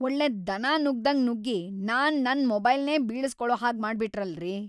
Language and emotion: Kannada, angry